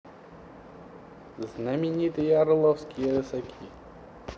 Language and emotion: Russian, positive